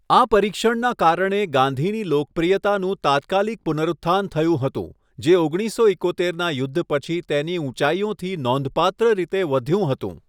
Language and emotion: Gujarati, neutral